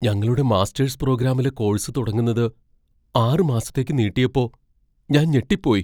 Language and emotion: Malayalam, fearful